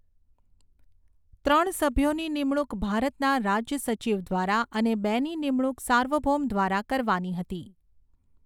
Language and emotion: Gujarati, neutral